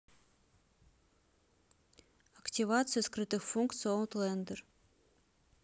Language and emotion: Russian, neutral